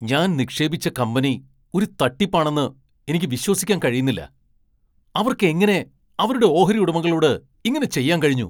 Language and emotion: Malayalam, angry